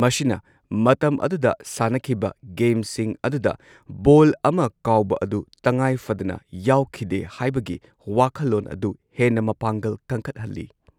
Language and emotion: Manipuri, neutral